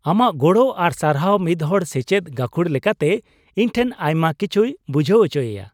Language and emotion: Santali, happy